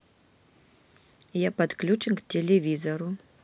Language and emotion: Russian, neutral